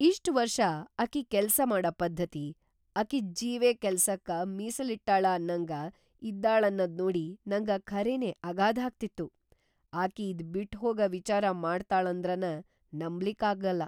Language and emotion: Kannada, surprised